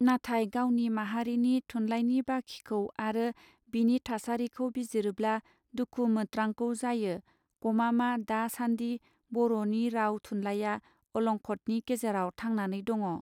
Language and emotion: Bodo, neutral